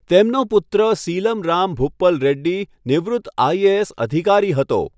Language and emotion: Gujarati, neutral